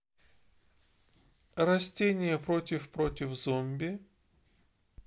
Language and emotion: Russian, neutral